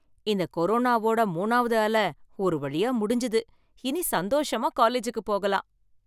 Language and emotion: Tamil, happy